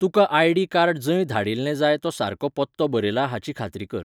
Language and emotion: Goan Konkani, neutral